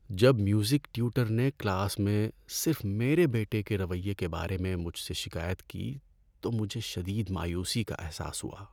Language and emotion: Urdu, sad